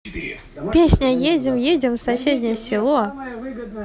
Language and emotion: Russian, positive